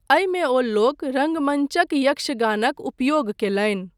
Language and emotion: Maithili, neutral